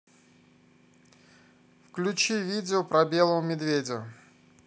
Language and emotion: Russian, neutral